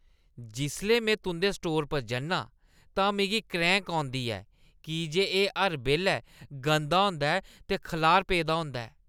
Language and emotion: Dogri, disgusted